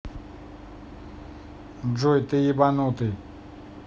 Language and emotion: Russian, angry